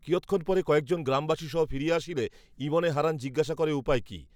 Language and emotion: Bengali, neutral